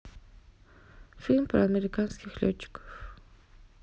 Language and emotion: Russian, neutral